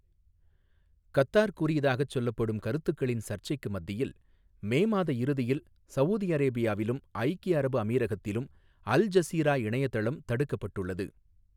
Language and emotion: Tamil, neutral